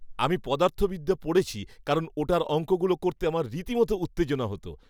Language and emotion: Bengali, happy